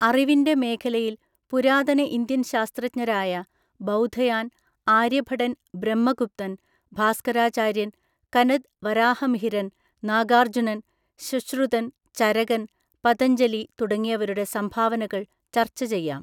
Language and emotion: Malayalam, neutral